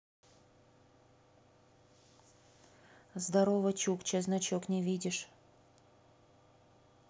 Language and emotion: Russian, neutral